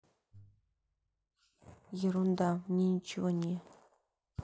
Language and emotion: Russian, neutral